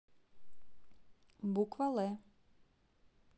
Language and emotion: Russian, neutral